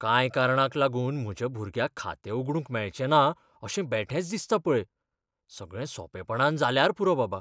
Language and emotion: Goan Konkani, fearful